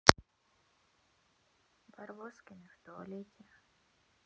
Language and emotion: Russian, neutral